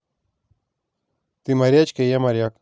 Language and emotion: Russian, neutral